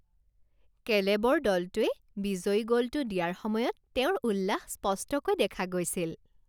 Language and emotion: Assamese, happy